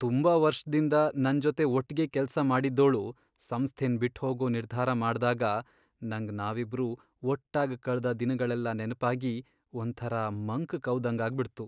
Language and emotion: Kannada, sad